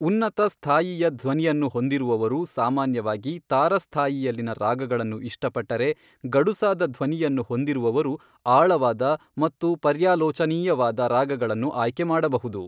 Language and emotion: Kannada, neutral